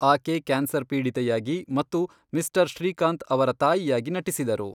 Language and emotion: Kannada, neutral